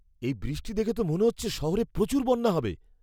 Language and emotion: Bengali, fearful